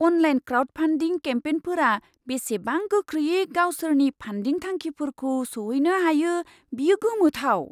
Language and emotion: Bodo, surprised